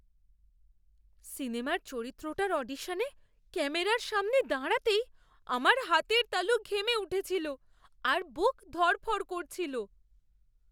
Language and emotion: Bengali, fearful